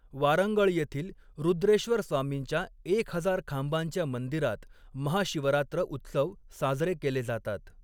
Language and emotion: Marathi, neutral